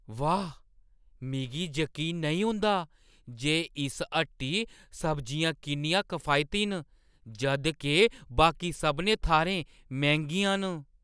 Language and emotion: Dogri, surprised